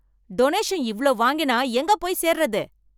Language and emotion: Tamil, angry